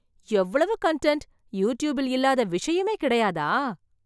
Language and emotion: Tamil, surprised